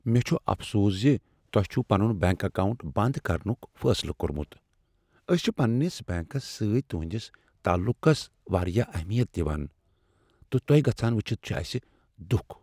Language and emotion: Kashmiri, sad